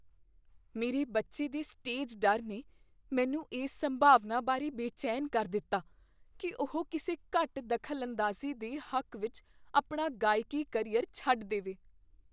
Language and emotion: Punjabi, fearful